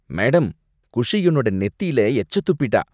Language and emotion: Tamil, disgusted